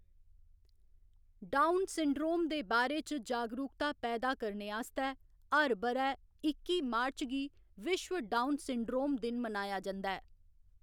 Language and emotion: Dogri, neutral